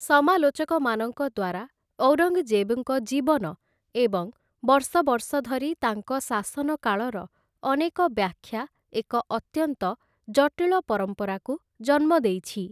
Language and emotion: Odia, neutral